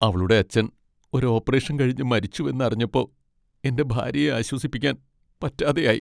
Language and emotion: Malayalam, sad